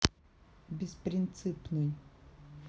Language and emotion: Russian, neutral